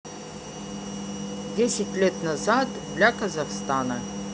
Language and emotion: Russian, neutral